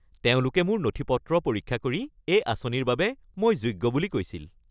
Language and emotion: Assamese, happy